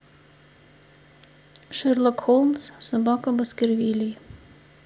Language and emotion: Russian, neutral